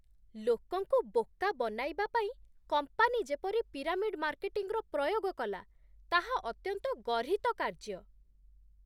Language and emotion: Odia, disgusted